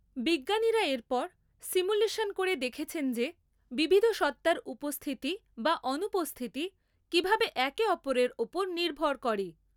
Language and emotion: Bengali, neutral